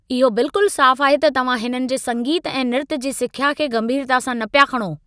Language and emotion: Sindhi, angry